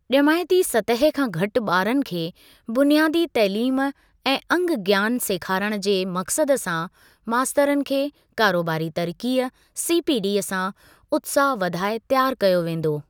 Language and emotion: Sindhi, neutral